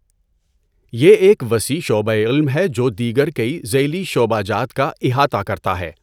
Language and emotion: Urdu, neutral